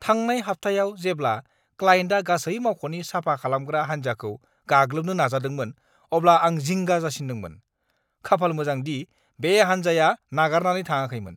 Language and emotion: Bodo, angry